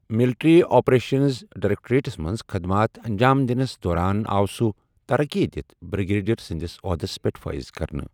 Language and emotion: Kashmiri, neutral